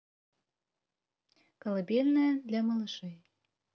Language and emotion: Russian, neutral